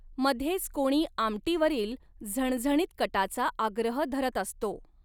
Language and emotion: Marathi, neutral